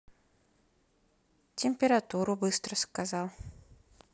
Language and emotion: Russian, neutral